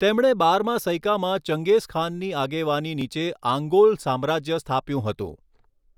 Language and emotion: Gujarati, neutral